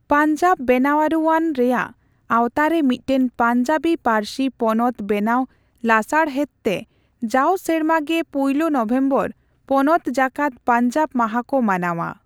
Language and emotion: Santali, neutral